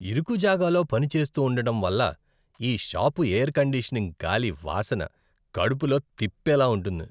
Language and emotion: Telugu, disgusted